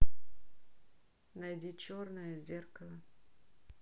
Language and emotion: Russian, neutral